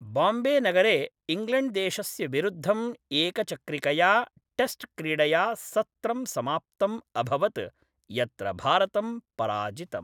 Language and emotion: Sanskrit, neutral